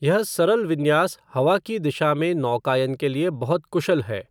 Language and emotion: Hindi, neutral